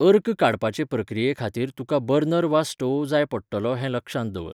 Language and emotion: Goan Konkani, neutral